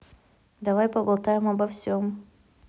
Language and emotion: Russian, neutral